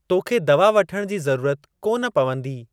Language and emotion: Sindhi, neutral